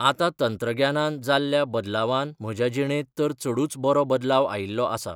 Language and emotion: Goan Konkani, neutral